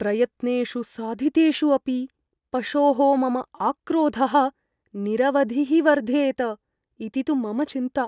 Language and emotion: Sanskrit, fearful